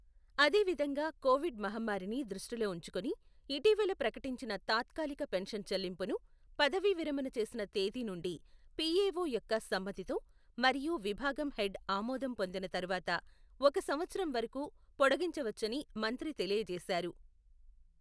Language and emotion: Telugu, neutral